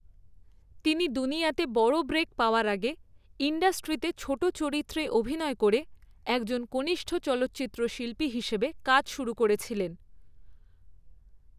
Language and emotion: Bengali, neutral